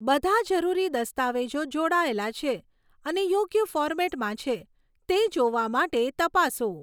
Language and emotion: Gujarati, neutral